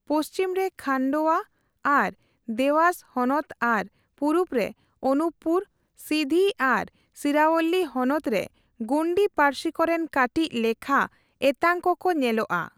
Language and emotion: Santali, neutral